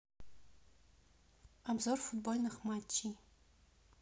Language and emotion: Russian, neutral